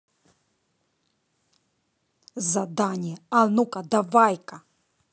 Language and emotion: Russian, angry